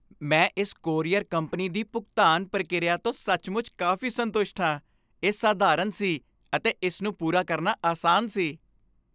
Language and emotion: Punjabi, happy